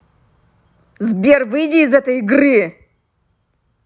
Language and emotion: Russian, angry